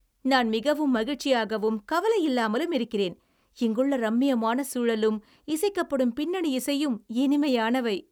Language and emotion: Tamil, happy